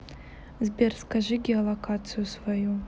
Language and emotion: Russian, neutral